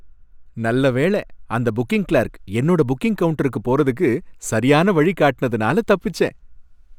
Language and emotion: Tamil, happy